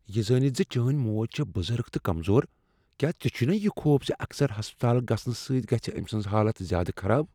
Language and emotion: Kashmiri, fearful